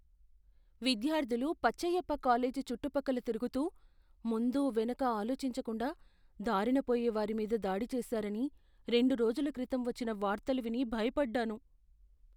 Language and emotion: Telugu, fearful